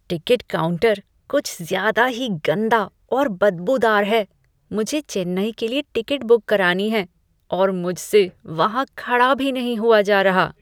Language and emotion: Hindi, disgusted